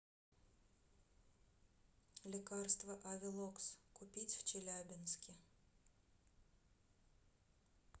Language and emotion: Russian, neutral